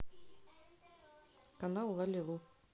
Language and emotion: Russian, neutral